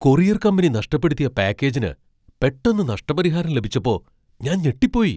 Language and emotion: Malayalam, surprised